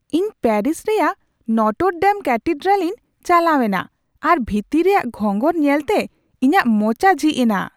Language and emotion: Santali, surprised